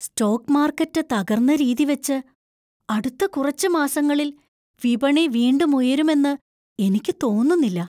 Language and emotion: Malayalam, fearful